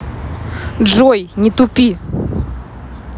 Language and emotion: Russian, angry